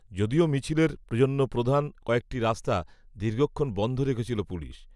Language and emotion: Bengali, neutral